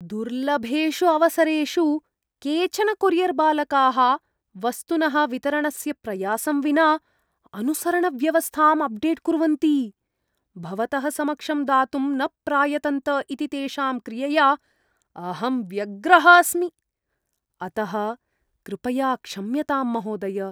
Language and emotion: Sanskrit, disgusted